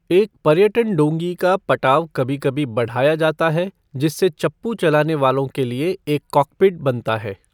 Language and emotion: Hindi, neutral